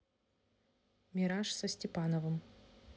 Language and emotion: Russian, neutral